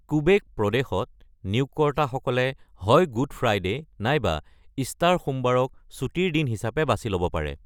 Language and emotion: Assamese, neutral